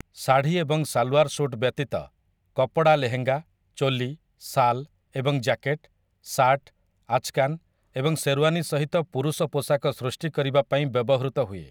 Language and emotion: Odia, neutral